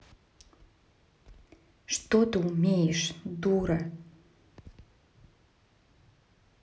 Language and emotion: Russian, angry